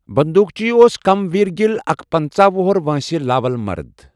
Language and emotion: Kashmiri, neutral